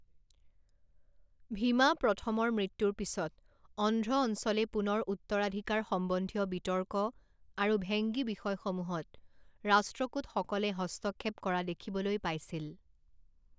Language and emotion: Assamese, neutral